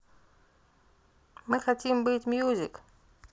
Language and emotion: Russian, neutral